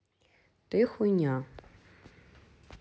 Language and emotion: Russian, neutral